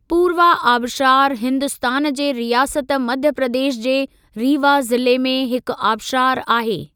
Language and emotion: Sindhi, neutral